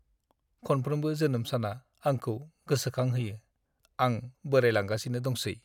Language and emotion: Bodo, sad